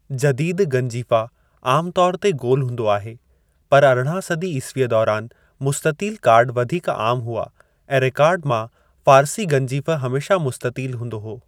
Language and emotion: Sindhi, neutral